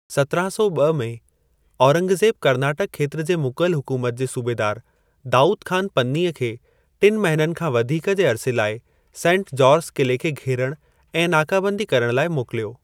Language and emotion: Sindhi, neutral